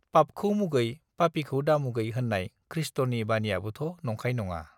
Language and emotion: Bodo, neutral